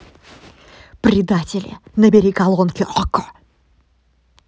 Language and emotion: Russian, angry